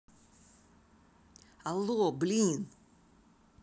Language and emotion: Russian, angry